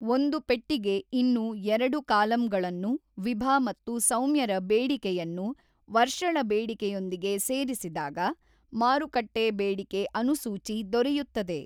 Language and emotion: Kannada, neutral